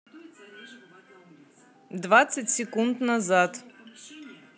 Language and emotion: Russian, neutral